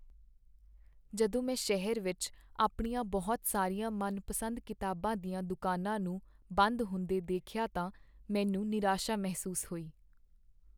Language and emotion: Punjabi, sad